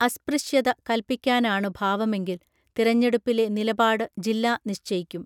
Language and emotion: Malayalam, neutral